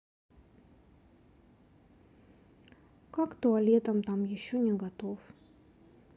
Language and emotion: Russian, sad